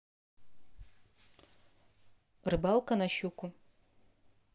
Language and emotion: Russian, neutral